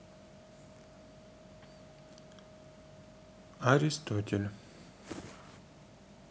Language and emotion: Russian, neutral